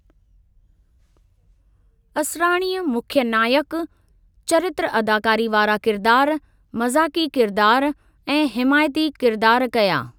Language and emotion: Sindhi, neutral